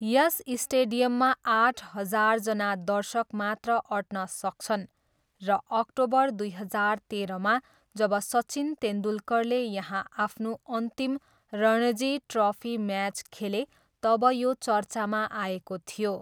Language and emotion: Nepali, neutral